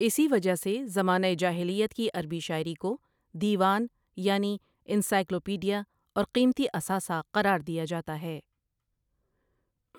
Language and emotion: Urdu, neutral